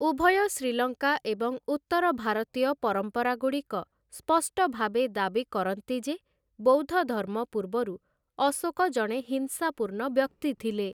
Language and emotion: Odia, neutral